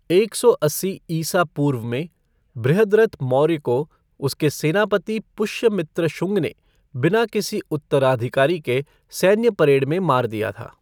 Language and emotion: Hindi, neutral